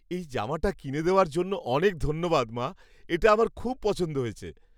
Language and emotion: Bengali, happy